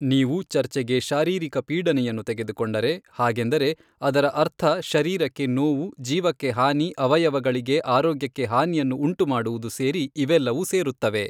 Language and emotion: Kannada, neutral